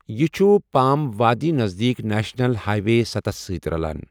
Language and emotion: Kashmiri, neutral